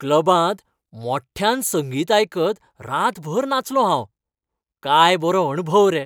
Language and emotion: Goan Konkani, happy